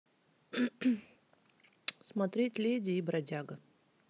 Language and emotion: Russian, neutral